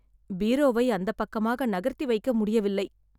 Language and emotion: Tamil, sad